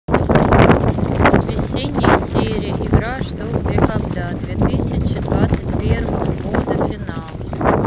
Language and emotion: Russian, neutral